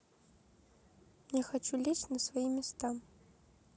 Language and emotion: Russian, neutral